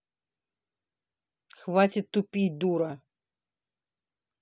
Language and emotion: Russian, angry